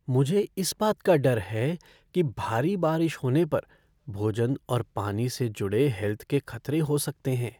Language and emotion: Hindi, fearful